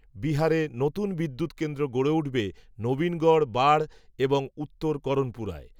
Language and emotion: Bengali, neutral